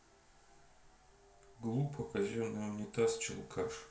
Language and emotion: Russian, neutral